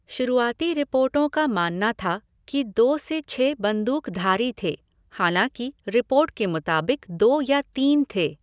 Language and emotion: Hindi, neutral